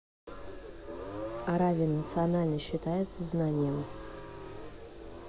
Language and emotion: Russian, neutral